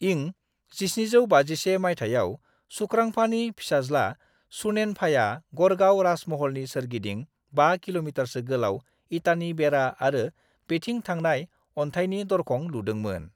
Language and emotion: Bodo, neutral